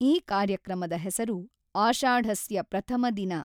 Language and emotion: Kannada, neutral